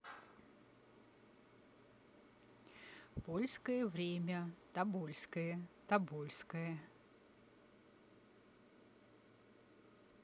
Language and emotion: Russian, neutral